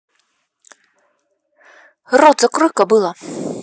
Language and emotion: Russian, angry